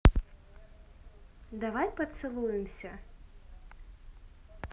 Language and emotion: Russian, neutral